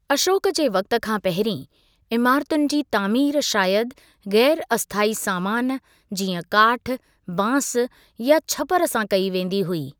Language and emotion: Sindhi, neutral